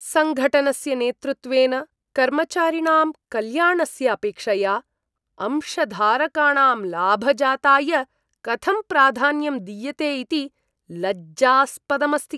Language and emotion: Sanskrit, disgusted